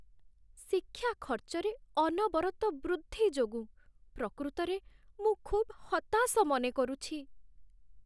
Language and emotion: Odia, sad